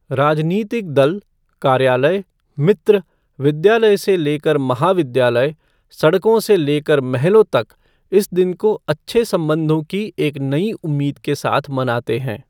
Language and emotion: Hindi, neutral